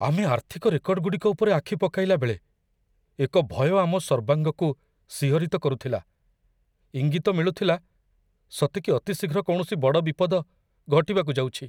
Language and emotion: Odia, fearful